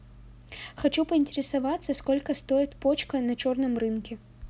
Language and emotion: Russian, neutral